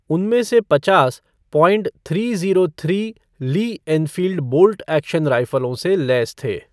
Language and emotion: Hindi, neutral